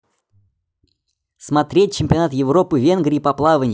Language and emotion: Russian, neutral